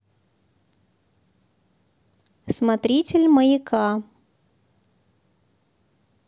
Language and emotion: Russian, positive